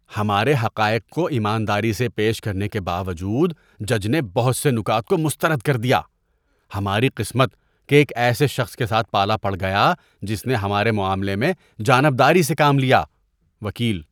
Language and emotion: Urdu, disgusted